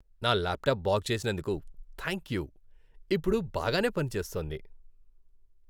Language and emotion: Telugu, happy